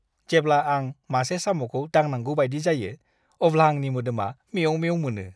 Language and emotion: Bodo, disgusted